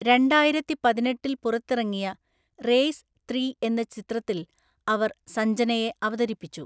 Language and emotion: Malayalam, neutral